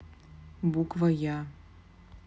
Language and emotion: Russian, neutral